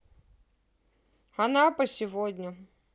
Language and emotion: Russian, neutral